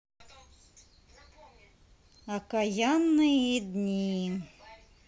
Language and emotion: Russian, neutral